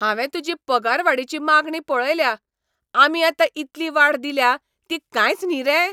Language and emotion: Goan Konkani, angry